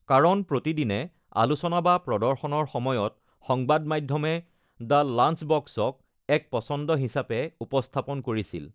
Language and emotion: Assamese, neutral